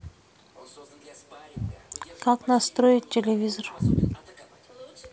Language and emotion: Russian, neutral